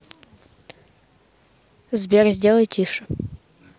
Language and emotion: Russian, neutral